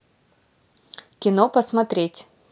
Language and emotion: Russian, neutral